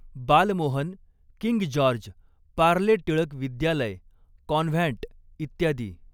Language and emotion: Marathi, neutral